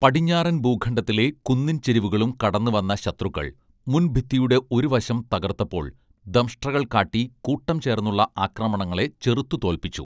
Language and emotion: Malayalam, neutral